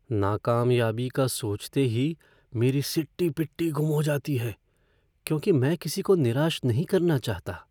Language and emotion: Hindi, fearful